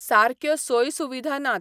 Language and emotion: Goan Konkani, neutral